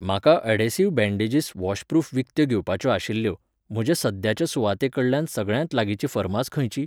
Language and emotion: Goan Konkani, neutral